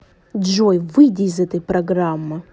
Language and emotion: Russian, angry